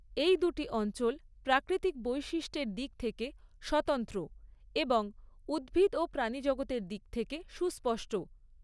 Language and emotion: Bengali, neutral